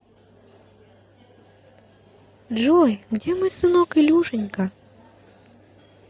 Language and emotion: Russian, positive